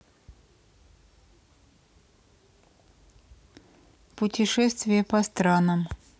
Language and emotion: Russian, neutral